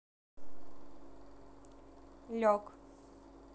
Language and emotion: Russian, neutral